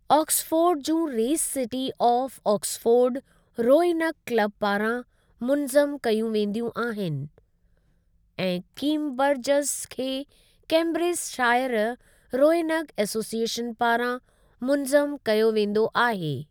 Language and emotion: Sindhi, neutral